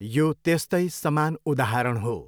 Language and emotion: Nepali, neutral